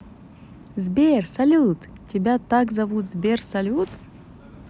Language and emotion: Russian, positive